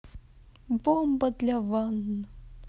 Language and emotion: Russian, neutral